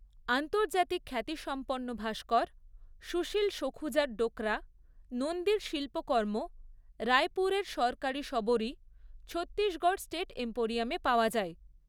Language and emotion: Bengali, neutral